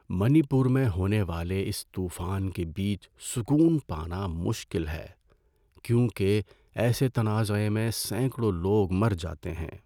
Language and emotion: Urdu, sad